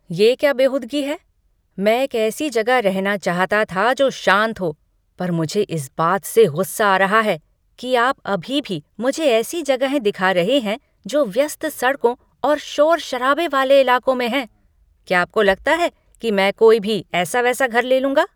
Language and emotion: Hindi, angry